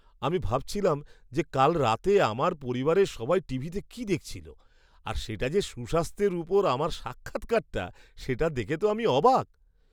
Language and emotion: Bengali, surprised